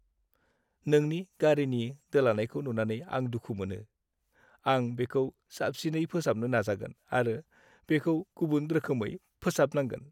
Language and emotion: Bodo, sad